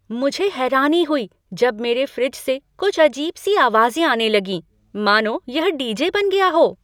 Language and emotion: Hindi, surprised